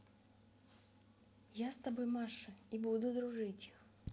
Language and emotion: Russian, neutral